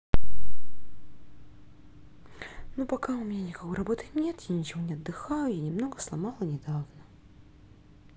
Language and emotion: Russian, sad